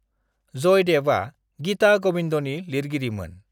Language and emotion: Bodo, neutral